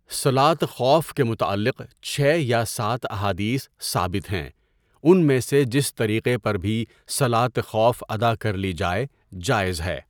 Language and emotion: Urdu, neutral